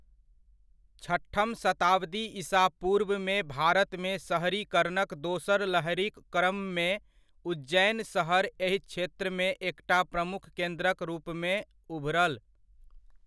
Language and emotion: Maithili, neutral